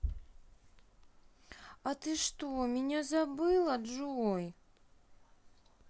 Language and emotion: Russian, sad